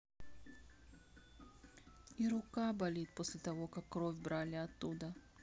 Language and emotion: Russian, sad